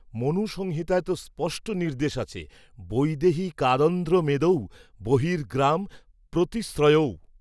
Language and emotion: Bengali, neutral